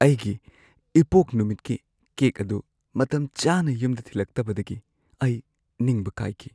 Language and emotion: Manipuri, sad